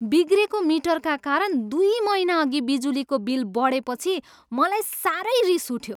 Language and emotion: Nepali, angry